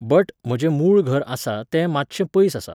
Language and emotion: Goan Konkani, neutral